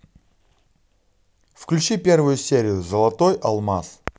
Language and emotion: Russian, positive